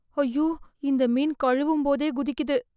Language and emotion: Tamil, fearful